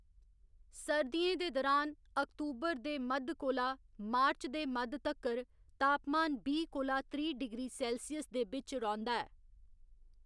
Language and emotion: Dogri, neutral